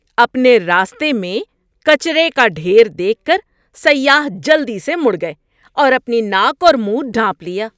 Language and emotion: Urdu, disgusted